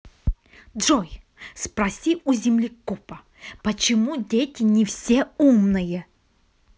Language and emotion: Russian, angry